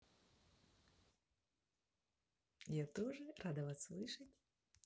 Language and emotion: Russian, neutral